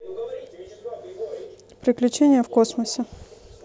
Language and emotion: Russian, neutral